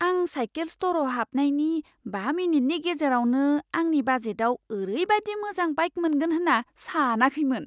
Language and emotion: Bodo, surprised